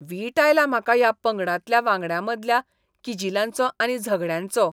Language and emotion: Goan Konkani, disgusted